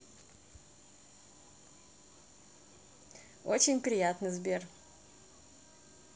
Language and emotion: Russian, positive